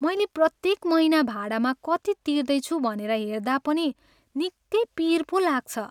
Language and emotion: Nepali, sad